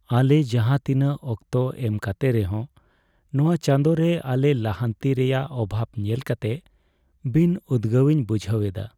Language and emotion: Santali, sad